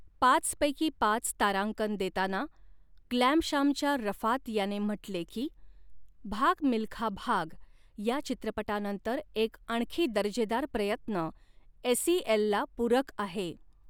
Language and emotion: Marathi, neutral